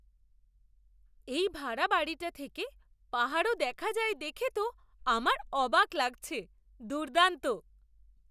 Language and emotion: Bengali, surprised